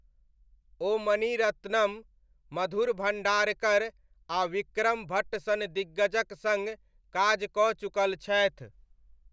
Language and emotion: Maithili, neutral